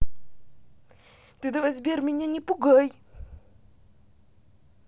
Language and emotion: Russian, angry